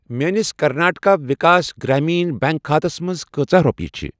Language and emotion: Kashmiri, neutral